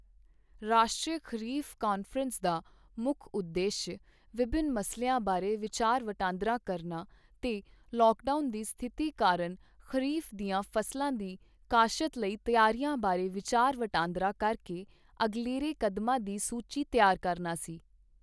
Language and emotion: Punjabi, neutral